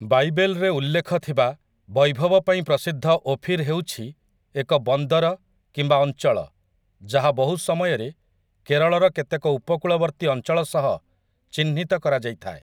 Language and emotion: Odia, neutral